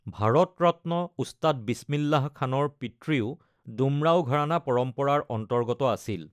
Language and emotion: Assamese, neutral